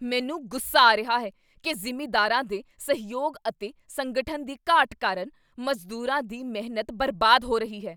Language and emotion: Punjabi, angry